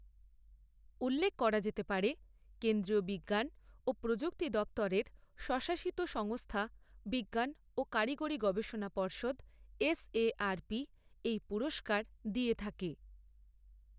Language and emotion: Bengali, neutral